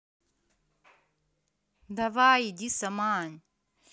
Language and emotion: Russian, angry